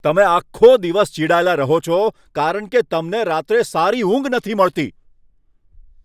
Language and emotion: Gujarati, angry